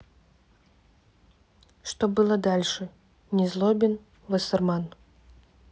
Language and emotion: Russian, neutral